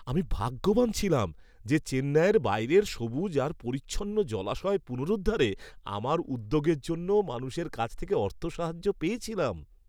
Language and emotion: Bengali, happy